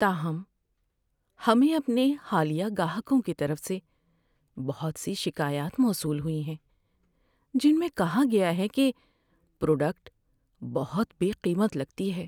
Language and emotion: Urdu, sad